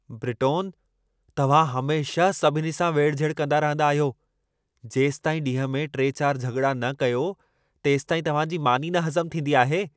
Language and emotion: Sindhi, angry